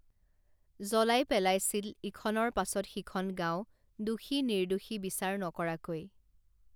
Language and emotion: Assamese, neutral